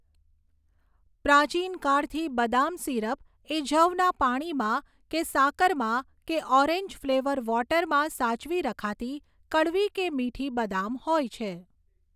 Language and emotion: Gujarati, neutral